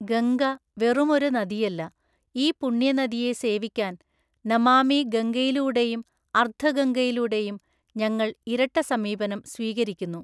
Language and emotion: Malayalam, neutral